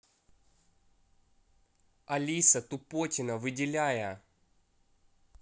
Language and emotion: Russian, angry